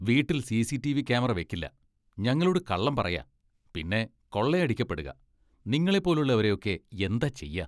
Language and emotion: Malayalam, disgusted